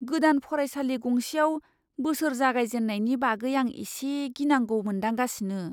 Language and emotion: Bodo, fearful